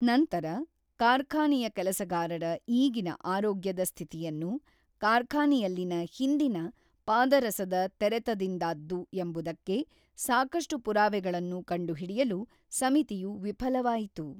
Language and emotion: Kannada, neutral